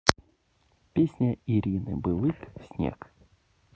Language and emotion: Russian, neutral